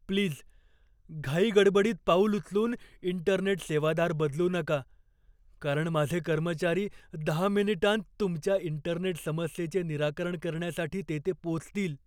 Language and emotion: Marathi, fearful